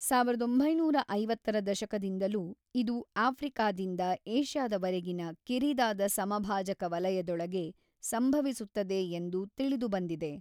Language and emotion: Kannada, neutral